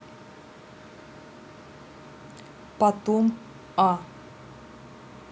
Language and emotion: Russian, neutral